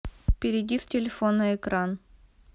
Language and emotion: Russian, neutral